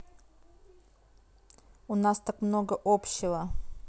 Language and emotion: Russian, neutral